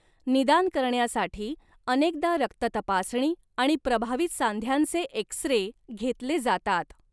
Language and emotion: Marathi, neutral